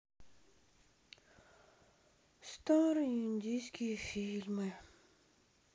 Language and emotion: Russian, sad